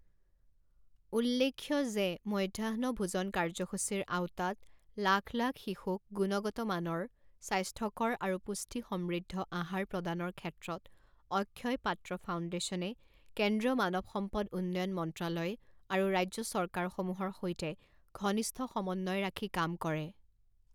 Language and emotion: Assamese, neutral